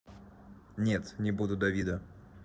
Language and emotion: Russian, neutral